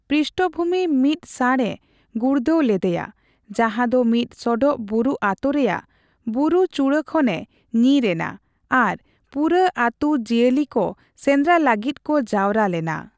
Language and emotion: Santali, neutral